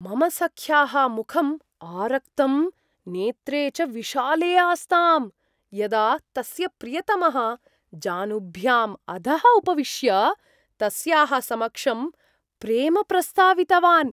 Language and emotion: Sanskrit, surprised